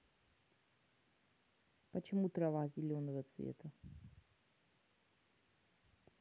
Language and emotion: Russian, neutral